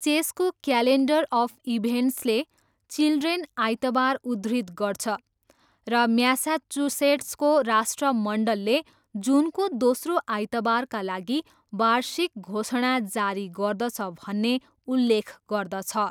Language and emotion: Nepali, neutral